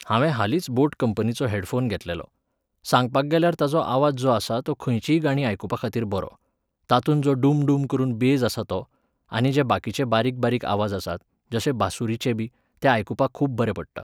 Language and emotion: Goan Konkani, neutral